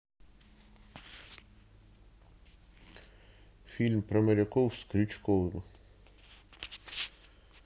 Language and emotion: Russian, neutral